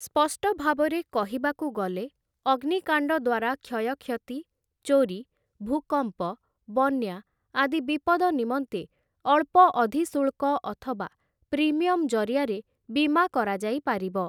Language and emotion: Odia, neutral